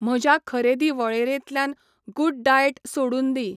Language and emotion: Goan Konkani, neutral